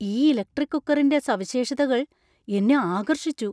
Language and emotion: Malayalam, surprised